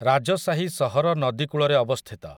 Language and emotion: Odia, neutral